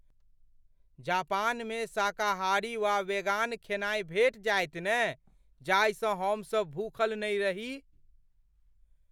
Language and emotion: Maithili, fearful